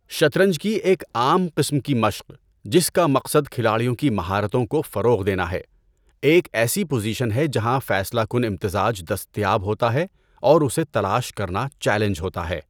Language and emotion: Urdu, neutral